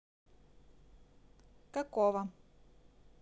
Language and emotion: Russian, neutral